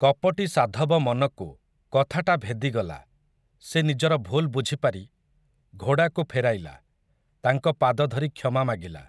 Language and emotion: Odia, neutral